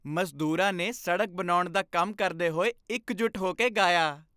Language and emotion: Punjabi, happy